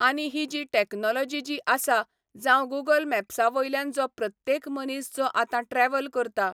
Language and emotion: Goan Konkani, neutral